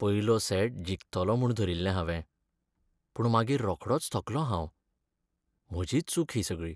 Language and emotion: Goan Konkani, sad